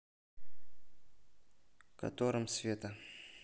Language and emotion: Russian, neutral